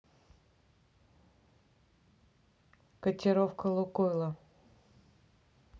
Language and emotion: Russian, neutral